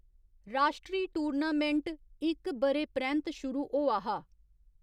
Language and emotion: Dogri, neutral